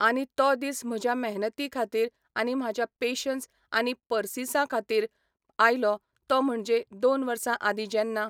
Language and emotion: Goan Konkani, neutral